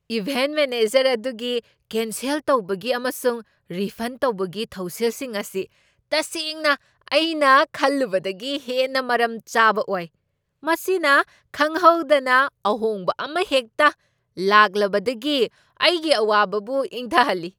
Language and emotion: Manipuri, surprised